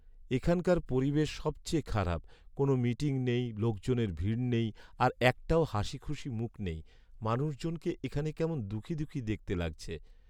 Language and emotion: Bengali, sad